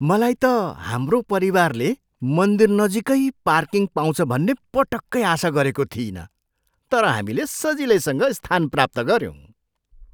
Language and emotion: Nepali, surprised